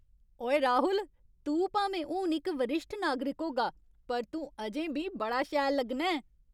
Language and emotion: Dogri, happy